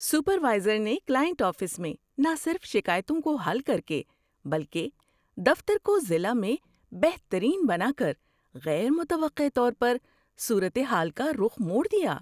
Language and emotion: Urdu, surprised